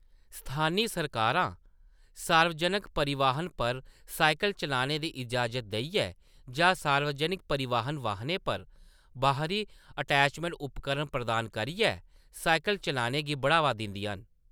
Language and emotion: Dogri, neutral